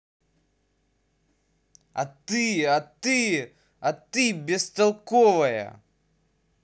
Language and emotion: Russian, angry